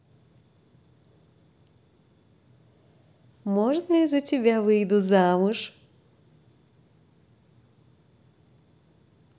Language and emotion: Russian, positive